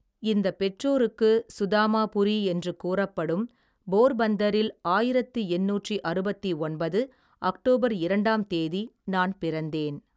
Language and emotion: Tamil, neutral